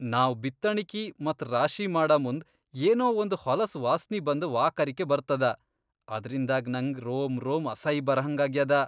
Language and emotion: Kannada, disgusted